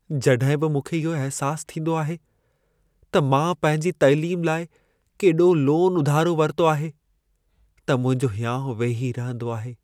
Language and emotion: Sindhi, sad